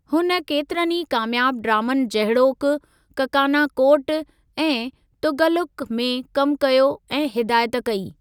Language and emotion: Sindhi, neutral